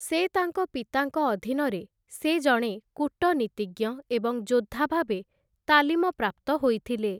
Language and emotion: Odia, neutral